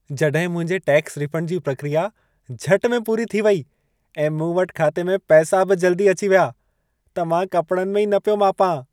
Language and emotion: Sindhi, happy